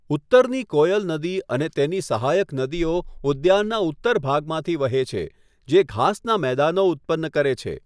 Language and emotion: Gujarati, neutral